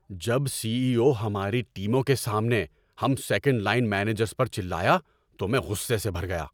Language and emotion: Urdu, angry